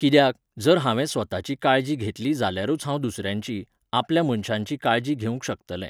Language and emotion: Goan Konkani, neutral